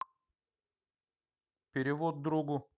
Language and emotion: Russian, neutral